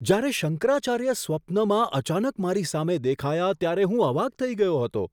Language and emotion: Gujarati, surprised